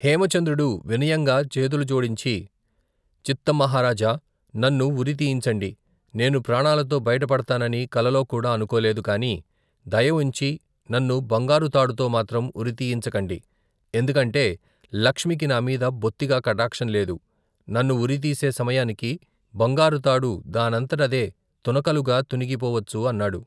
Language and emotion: Telugu, neutral